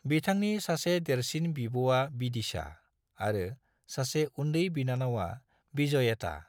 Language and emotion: Bodo, neutral